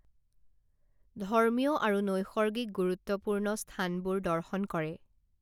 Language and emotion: Assamese, neutral